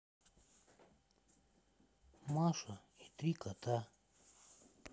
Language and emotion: Russian, sad